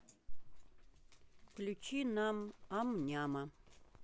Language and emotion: Russian, neutral